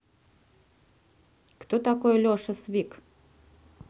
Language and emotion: Russian, neutral